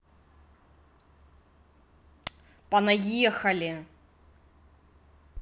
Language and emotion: Russian, angry